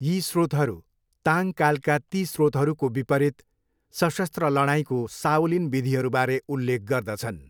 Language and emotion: Nepali, neutral